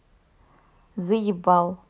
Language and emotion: Russian, neutral